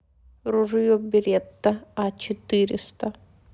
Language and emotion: Russian, neutral